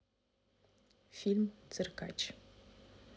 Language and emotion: Russian, neutral